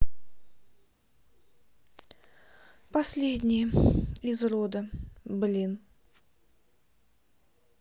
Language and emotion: Russian, sad